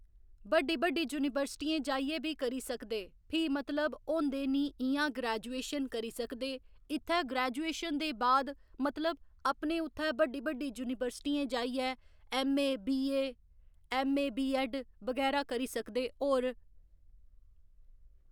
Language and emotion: Dogri, neutral